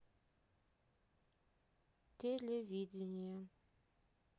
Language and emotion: Russian, neutral